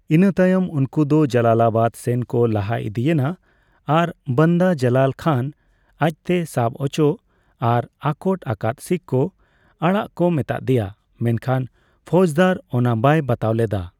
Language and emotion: Santali, neutral